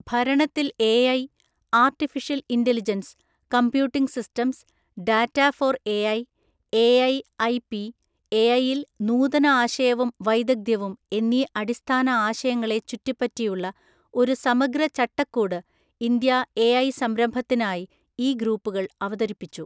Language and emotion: Malayalam, neutral